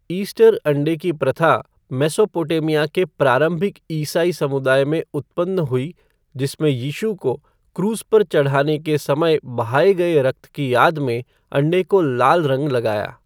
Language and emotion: Hindi, neutral